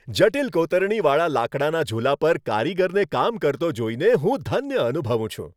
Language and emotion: Gujarati, happy